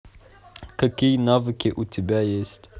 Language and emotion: Russian, neutral